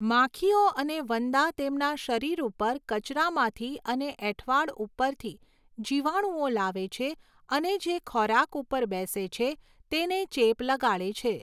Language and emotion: Gujarati, neutral